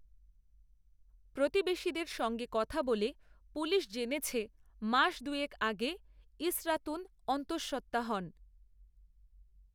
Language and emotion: Bengali, neutral